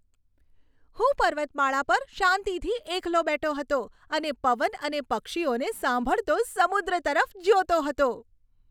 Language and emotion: Gujarati, happy